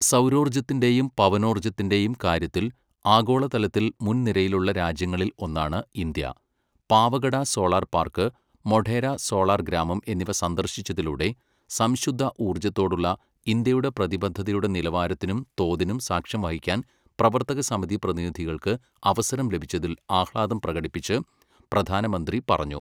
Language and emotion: Malayalam, neutral